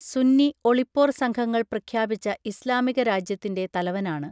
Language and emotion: Malayalam, neutral